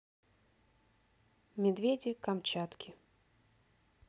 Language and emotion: Russian, neutral